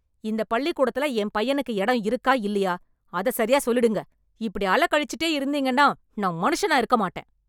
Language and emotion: Tamil, angry